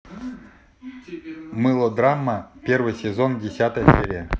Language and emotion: Russian, neutral